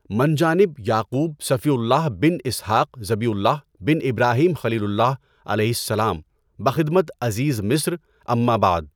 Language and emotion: Urdu, neutral